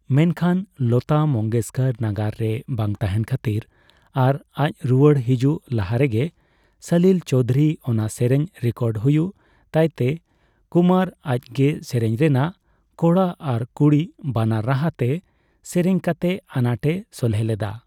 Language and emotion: Santali, neutral